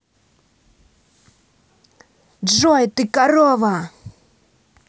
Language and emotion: Russian, angry